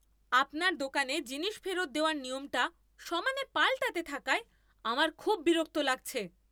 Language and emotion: Bengali, angry